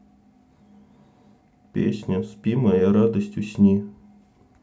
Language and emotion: Russian, neutral